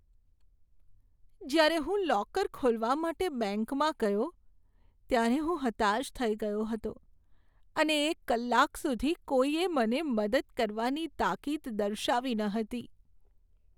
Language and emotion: Gujarati, sad